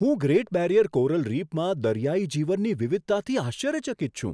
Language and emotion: Gujarati, surprised